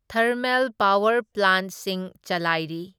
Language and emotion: Manipuri, neutral